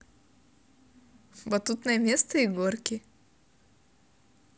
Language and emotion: Russian, positive